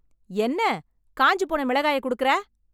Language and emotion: Tamil, angry